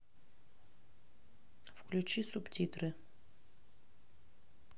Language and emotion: Russian, neutral